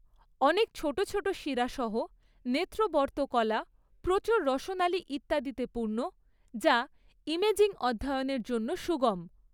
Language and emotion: Bengali, neutral